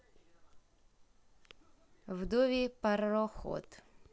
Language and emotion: Russian, neutral